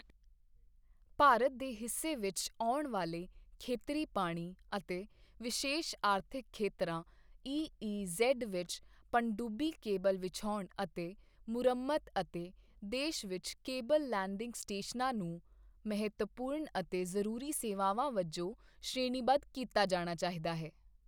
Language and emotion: Punjabi, neutral